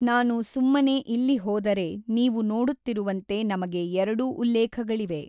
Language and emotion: Kannada, neutral